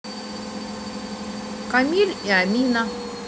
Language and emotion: Russian, neutral